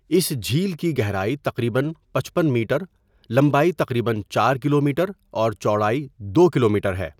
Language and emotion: Urdu, neutral